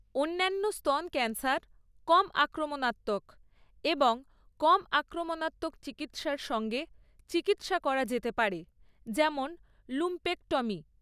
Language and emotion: Bengali, neutral